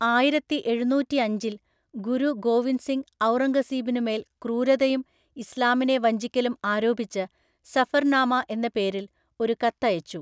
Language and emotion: Malayalam, neutral